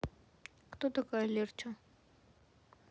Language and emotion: Russian, neutral